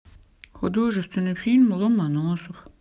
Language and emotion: Russian, sad